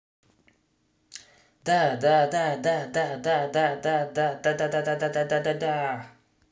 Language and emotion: Russian, positive